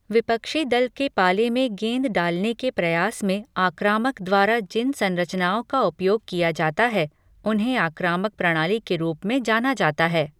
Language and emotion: Hindi, neutral